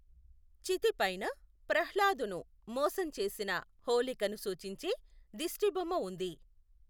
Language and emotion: Telugu, neutral